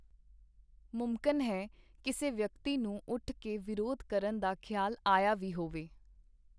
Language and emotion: Punjabi, neutral